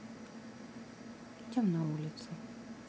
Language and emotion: Russian, neutral